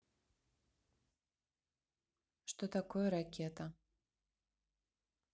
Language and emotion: Russian, neutral